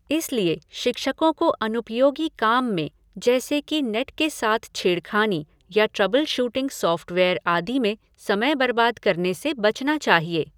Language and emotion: Hindi, neutral